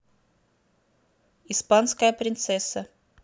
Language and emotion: Russian, neutral